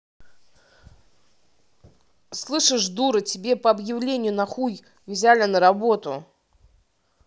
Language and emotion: Russian, angry